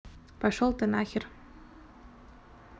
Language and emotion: Russian, neutral